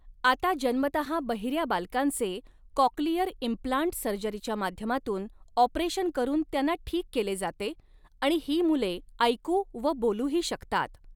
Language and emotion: Marathi, neutral